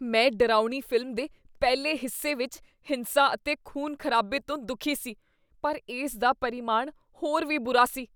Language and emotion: Punjabi, disgusted